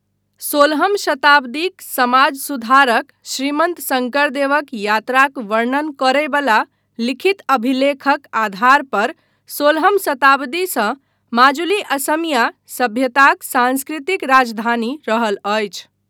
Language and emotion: Maithili, neutral